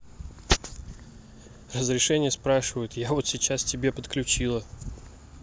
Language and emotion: Russian, neutral